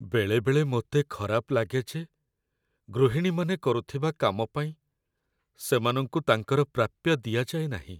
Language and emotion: Odia, sad